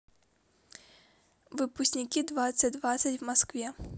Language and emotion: Russian, neutral